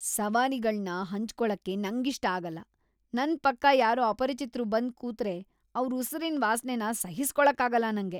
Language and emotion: Kannada, disgusted